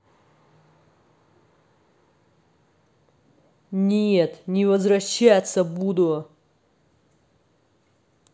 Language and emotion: Russian, angry